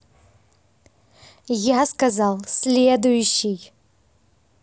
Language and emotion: Russian, angry